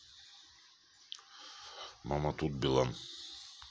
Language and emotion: Russian, neutral